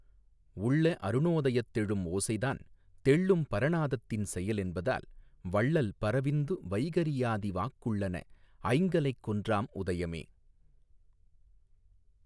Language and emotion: Tamil, neutral